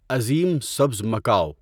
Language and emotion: Urdu, neutral